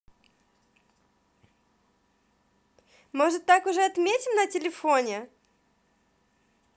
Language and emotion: Russian, positive